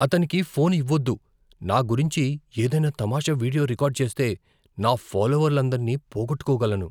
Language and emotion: Telugu, fearful